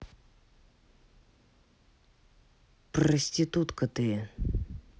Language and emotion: Russian, angry